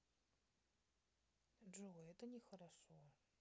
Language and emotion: Russian, sad